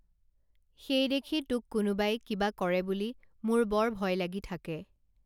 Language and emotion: Assamese, neutral